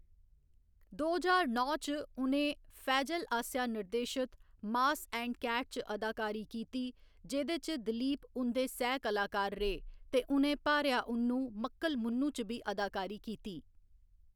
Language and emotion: Dogri, neutral